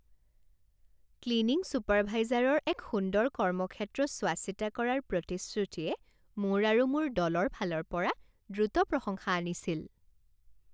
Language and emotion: Assamese, happy